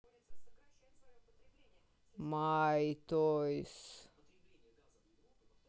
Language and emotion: Russian, sad